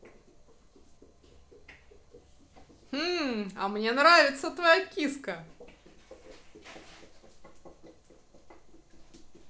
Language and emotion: Russian, positive